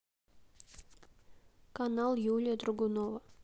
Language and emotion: Russian, neutral